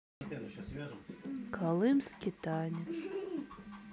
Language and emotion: Russian, sad